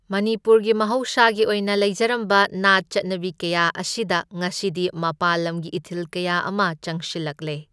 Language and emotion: Manipuri, neutral